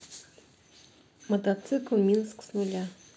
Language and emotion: Russian, neutral